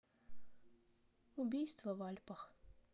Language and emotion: Russian, neutral